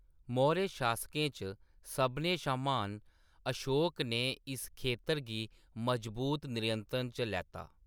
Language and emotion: Dogri, neutral